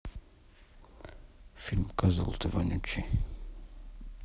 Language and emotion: Russian, neutral